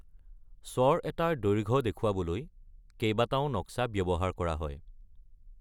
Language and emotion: Assamese, neutral